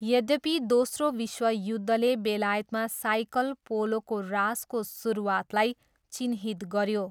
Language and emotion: Nepali, neutral